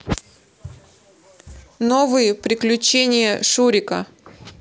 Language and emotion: Russian, positive